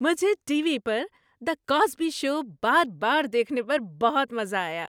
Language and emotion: Urdu, happy